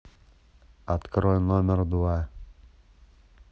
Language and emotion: Russian, neutral